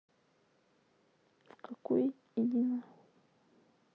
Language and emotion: Russian, sad